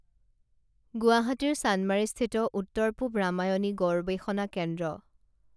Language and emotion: Assamese, neutral